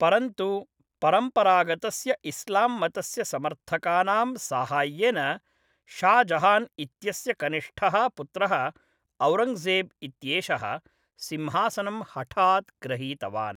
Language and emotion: Sanskrit, neutral